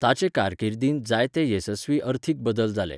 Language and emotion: Goan Konkani, neutral